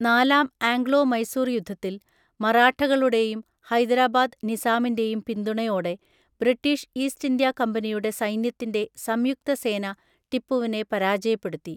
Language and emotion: Malayalam, neutral